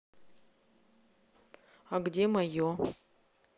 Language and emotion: Russian, neutral